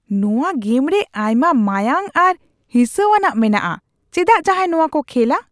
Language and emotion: Santali, disgusted